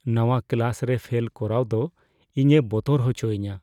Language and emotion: Santali, fearful